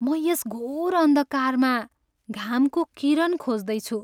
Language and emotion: Nepali, sad